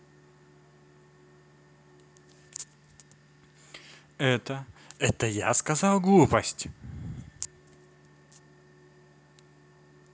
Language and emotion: Russian, angry